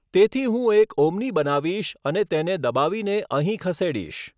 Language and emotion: Gujarati, neutral